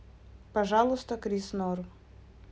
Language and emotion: Russian, neutral